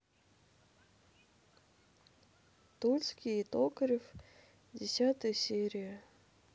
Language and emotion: Russian, sad